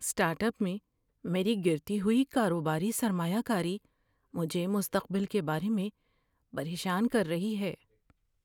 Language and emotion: Urdu, fearful